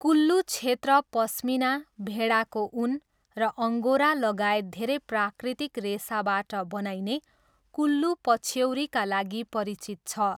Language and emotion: Nepali, neutral